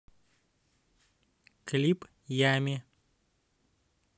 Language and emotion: Russian, neutral